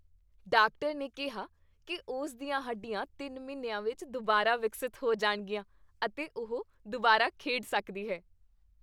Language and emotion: Punjabi, happy